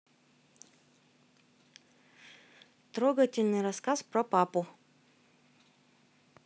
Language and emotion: Russian, neutral